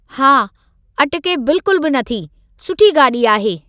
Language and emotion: Sindhi, neutral